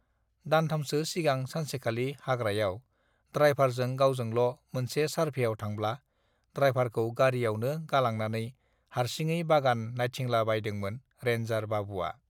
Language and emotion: Bodo, neutral